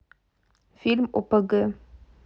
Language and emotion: Russian, neutral